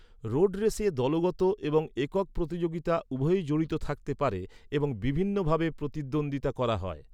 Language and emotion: Bengali, neutral